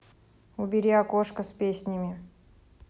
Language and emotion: Russian, neutral